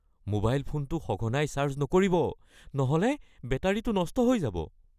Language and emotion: Assamese, fearful